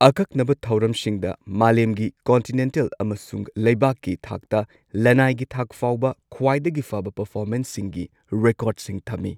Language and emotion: Manipuri, neutral